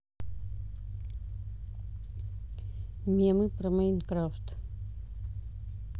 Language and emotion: Russian, neutral